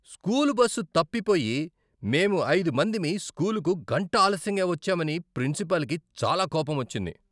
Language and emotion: Telugu, angry